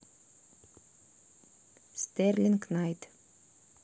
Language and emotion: Russian, neutral